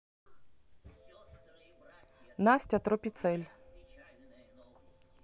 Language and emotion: Russian, neutral